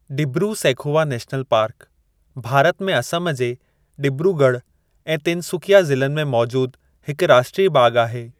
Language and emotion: Sindhi, neutral